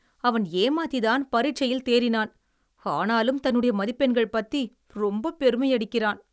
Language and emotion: Tamil, disgusted